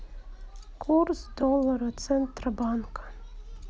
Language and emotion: Russian, sad